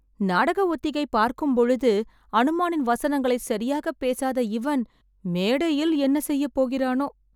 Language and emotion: Tamil, fearful